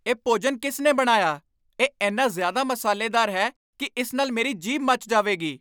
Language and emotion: Punjabi, angry